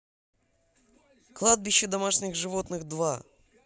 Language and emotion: Russian, positive